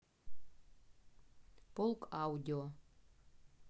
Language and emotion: Russian, neutral